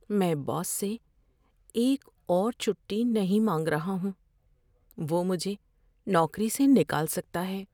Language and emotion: Urdu, fearful